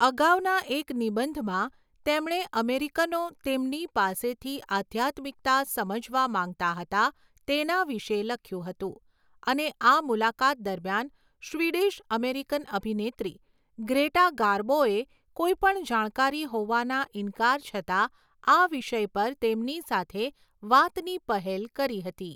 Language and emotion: Gujarati, neutral